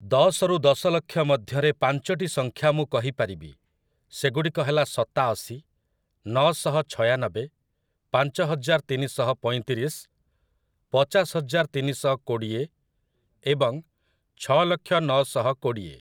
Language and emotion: Odia, neutral